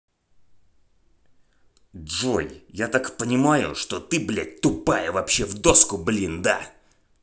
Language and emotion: Russian, angry